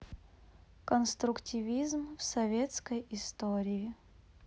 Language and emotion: Russian, neutral